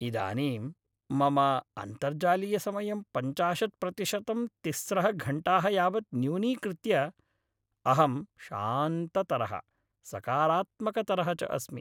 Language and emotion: Sanskrit, happy